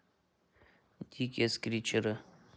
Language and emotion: Russian, neutral